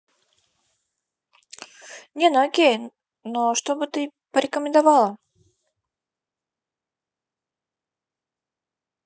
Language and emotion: Russian, neutral